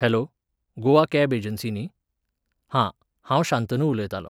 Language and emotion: Goan Konkani, neutral